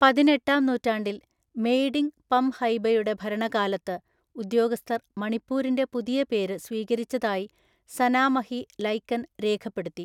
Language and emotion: Malayalam, neutral